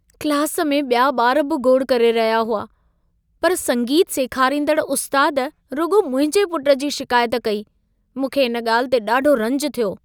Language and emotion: Sindhi, sad